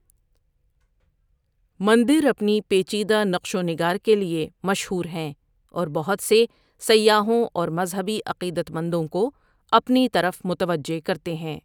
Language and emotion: Urdu, neutral